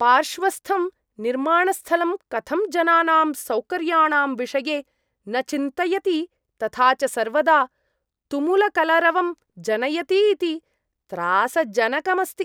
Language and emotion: Sanskrit, disgusted